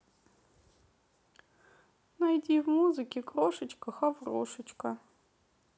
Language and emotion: Russian, sad